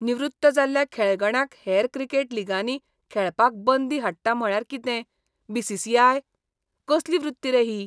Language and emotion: Goan Konkani, disgusted